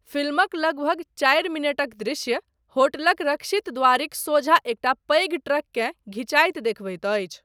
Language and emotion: Maithili, neutral